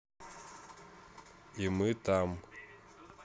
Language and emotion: Russian, neutral